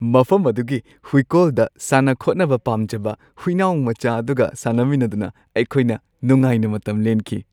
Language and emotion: Manipuri, happy